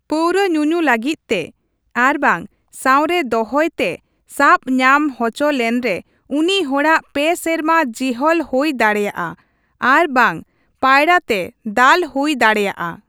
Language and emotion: Santali, neutral